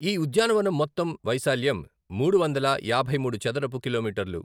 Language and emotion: Telugu, neutral